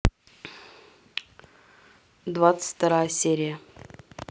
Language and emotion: Russian, neutral